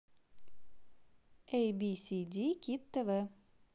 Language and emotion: Russian, positive